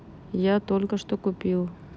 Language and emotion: Russian, neutral